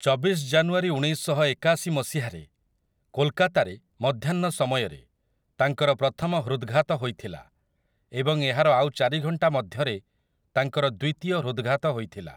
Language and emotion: Odia, neutral